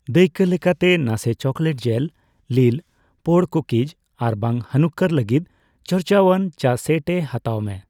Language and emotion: Santali, neutral